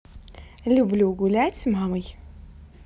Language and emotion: Russian, positive